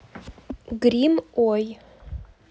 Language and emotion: Russian, neutral